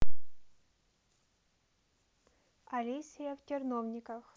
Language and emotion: Russian, neutral